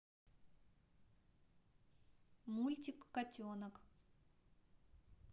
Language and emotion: Russian, neutral